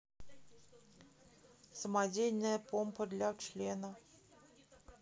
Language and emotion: Russian, neutral